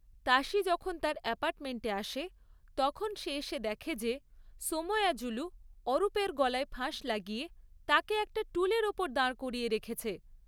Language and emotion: Bengali, neutral